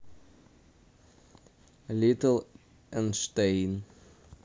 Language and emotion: Russian, neutral